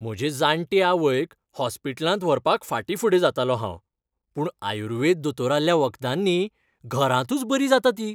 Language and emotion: Goan Konkani, happy